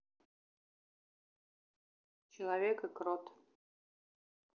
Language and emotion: Russian, neutral